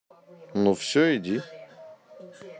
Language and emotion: Russian, neutral